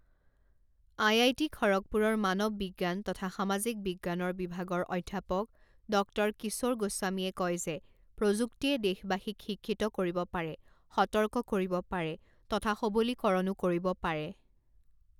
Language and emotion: Assamese, neutral